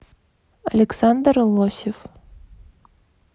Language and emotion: Russian, neutral